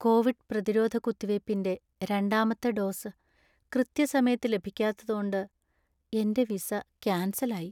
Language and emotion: Malayalam, sad